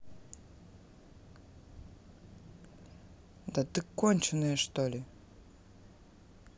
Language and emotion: Russian, angry